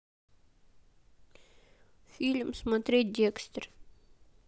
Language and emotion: Russian, sad